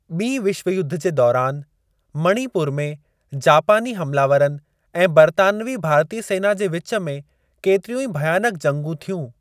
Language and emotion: Sindhi, neutral